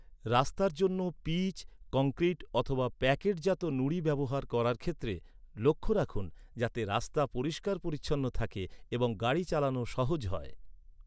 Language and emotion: Bengali, neutral